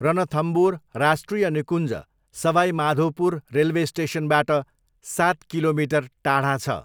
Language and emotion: Nepali, neutral